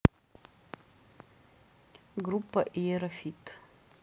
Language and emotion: Russian, neutral